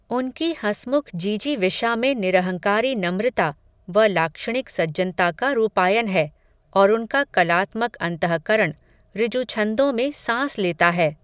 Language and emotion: Hindi, neutral